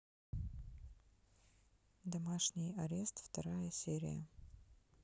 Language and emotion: Russian, neutral